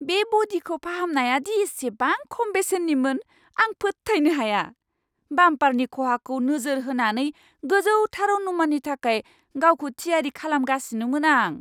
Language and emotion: Bodo, surprised